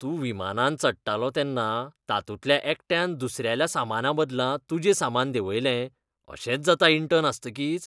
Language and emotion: Goan Konkani, disgusted